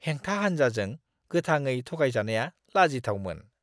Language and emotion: Bodo, disgusted